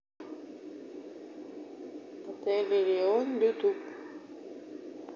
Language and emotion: Russian, neutral